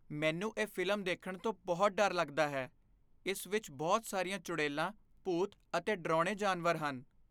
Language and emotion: Punjabi, fearful